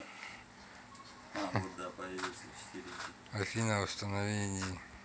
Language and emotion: Russian, neutral